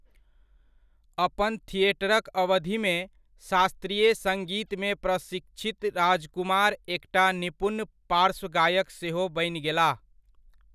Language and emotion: Maithili, neutral